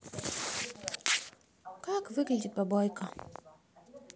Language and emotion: Russian, neutral